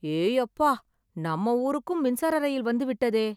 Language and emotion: Tamil, surprised